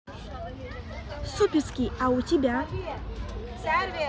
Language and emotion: Russian, positive